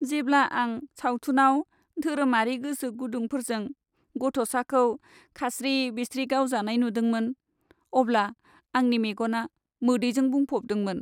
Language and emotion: Bodo, sad